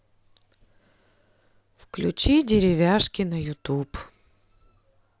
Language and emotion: Russian, neutral